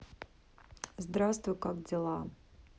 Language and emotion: Russian, neutral